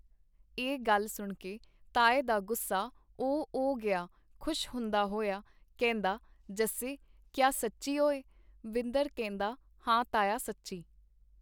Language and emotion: Punjabi, neutral